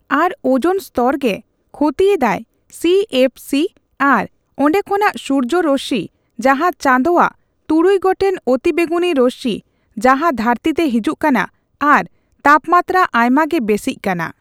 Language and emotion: Santali, neutral